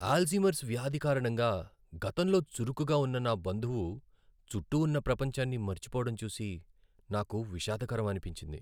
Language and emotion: Telugu, sad